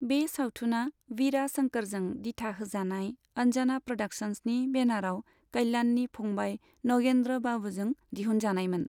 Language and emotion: Bodo, neutral